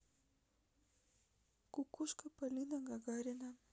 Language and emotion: Russian, sad